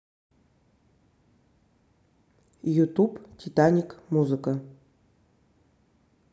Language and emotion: Russian, neutral